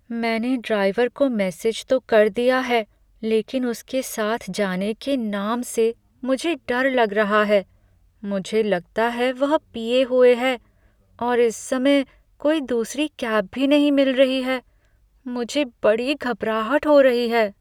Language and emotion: Hindi, fearful